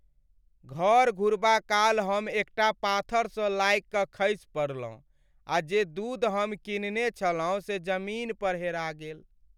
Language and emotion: Maithili, sad